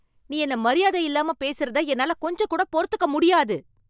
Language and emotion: Tamil, angry